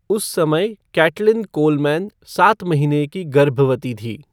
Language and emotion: Hindi, neutral